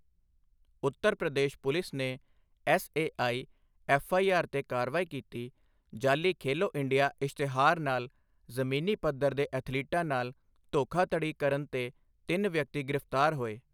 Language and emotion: Punjabi, neutral